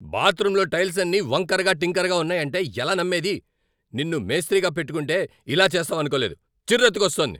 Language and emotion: Telugu, angry